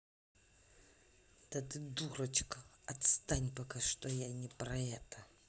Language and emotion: Russian, angry